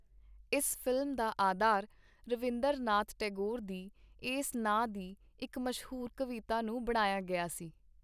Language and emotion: Punjabi, neutral